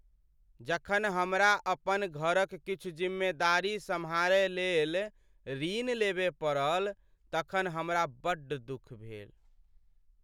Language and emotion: Maithili, sad